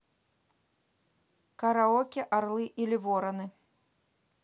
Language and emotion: Russian, neutral